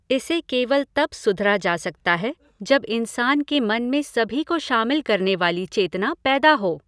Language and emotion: Hindi, neutral